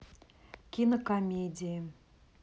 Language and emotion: Russian, neutral